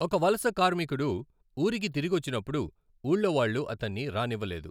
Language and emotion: Telugu, neutral